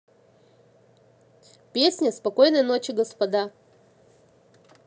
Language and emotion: Russian, neutral